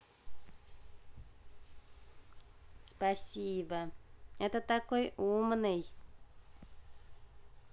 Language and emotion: Russian, neutral